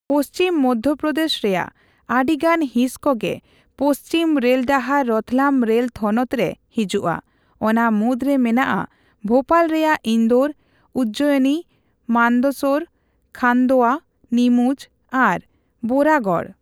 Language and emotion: Santali, neutral